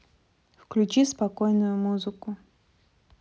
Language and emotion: Russian, neutral